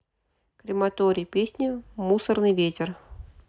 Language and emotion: Russian, neutral